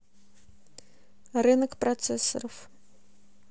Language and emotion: Russian, neutral